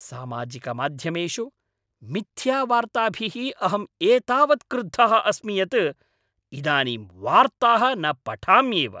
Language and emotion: Sanskrit, angry